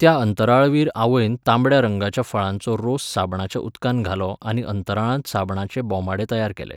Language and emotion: Goan Konkani, neutral